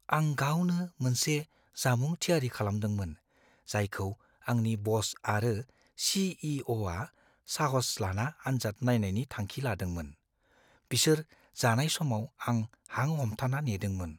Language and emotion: Bodo, fearful